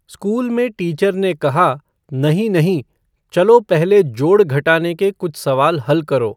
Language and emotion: Hindi, neutral